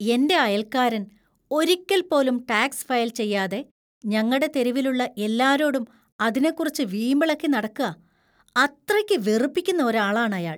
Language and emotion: Malayalam, disgusted